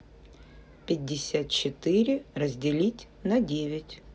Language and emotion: Russian, neutral